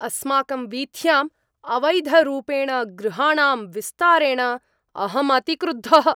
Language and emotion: Sanskrit, angry